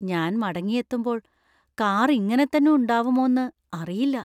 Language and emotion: Malayalam, fearful